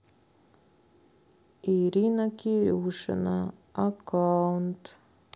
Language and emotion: Russian, sad